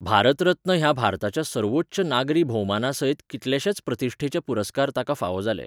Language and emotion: Goan Konkani, neutral